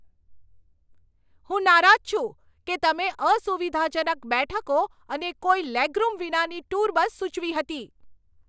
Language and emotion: Gujarati, angry